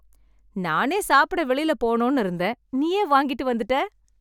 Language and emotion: Tamil, happy